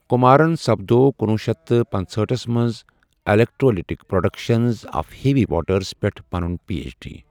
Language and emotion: Kashmiri, neutral